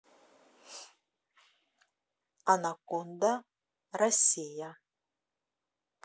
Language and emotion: Russian, neutral